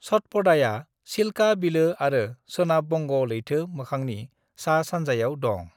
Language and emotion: Bodo, neutral